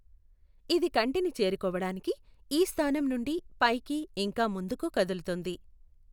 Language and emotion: Telugu, neutral